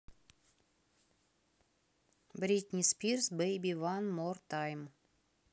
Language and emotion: Russian, neutral